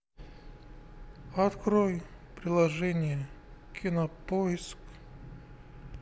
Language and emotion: Russian, sad